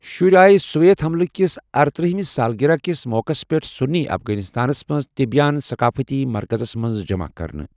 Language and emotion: Kashmiri, neutral